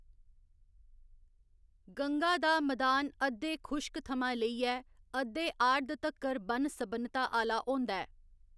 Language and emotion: Dogri, neutral